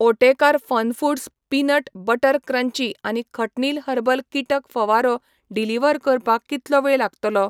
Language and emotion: Goan Konkani, neutral